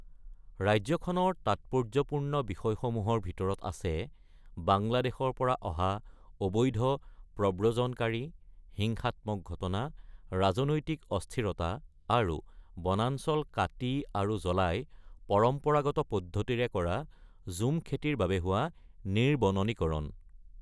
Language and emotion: Assamese, neutral